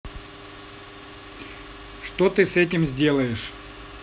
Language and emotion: Russian, neutral